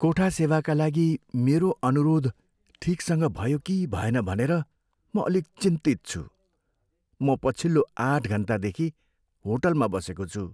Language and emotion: Nepali, fearful